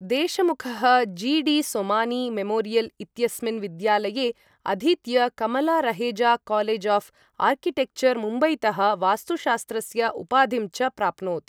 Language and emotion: Sanskrit, neutral